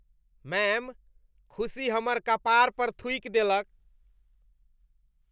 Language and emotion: Maithili, disgusted